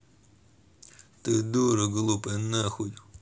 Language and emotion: Russian, angry